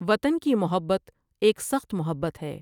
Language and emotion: Urdu, neutral